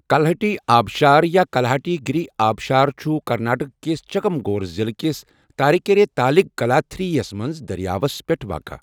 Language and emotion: Kashmiri, neutral